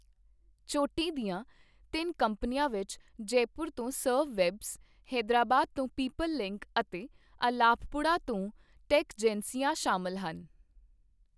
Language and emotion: Punjabi, neutral